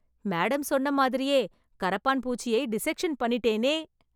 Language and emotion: Tamil, happy